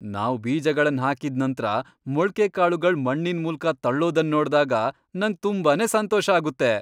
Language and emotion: Kannada, happy